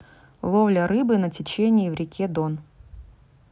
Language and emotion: Russian, neutral